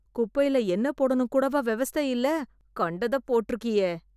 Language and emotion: Tamil, disgusted